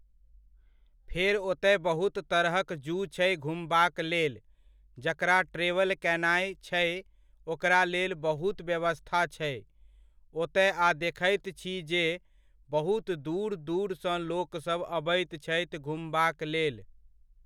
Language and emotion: Maithili, neutral